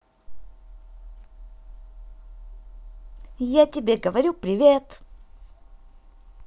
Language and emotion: Russian, positive